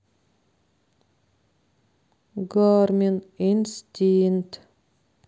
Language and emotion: Russian, neutral